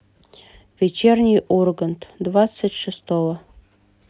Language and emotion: Russian, neutral